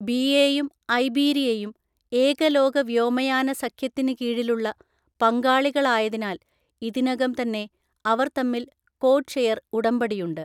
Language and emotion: Malayalam, neutral